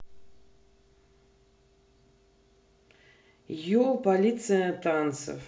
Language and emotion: Russian, neutral